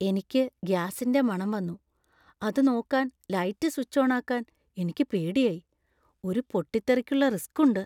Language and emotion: Malayalam, fearful